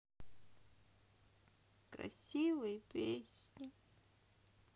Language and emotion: Russian, sad